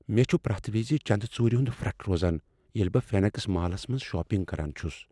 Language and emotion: Kashmiri, fearful